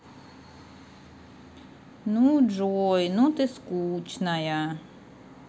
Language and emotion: Russian, sad